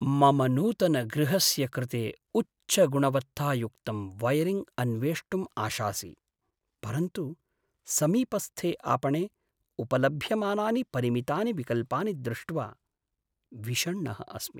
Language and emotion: Sanskrit, sad